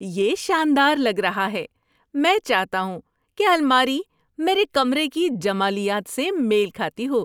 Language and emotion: Urdu, happy